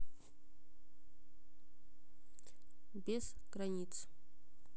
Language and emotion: Russian, neutral